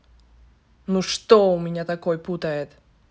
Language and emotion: Russian, angry